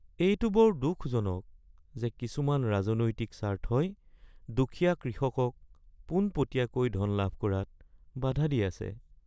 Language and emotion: Assamese, sad